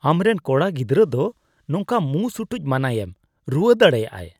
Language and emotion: Santali, disgusted